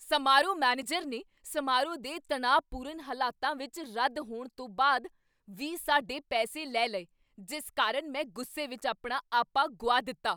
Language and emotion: Punjabi, angry